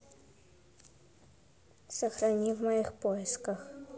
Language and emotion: Russian, neutral